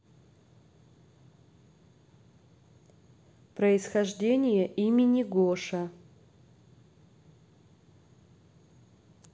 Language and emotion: Russian, neutral